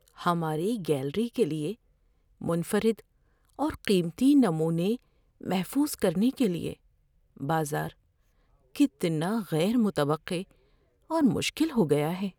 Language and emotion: Urdu, fearful